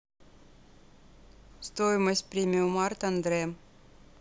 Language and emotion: Russian, neutral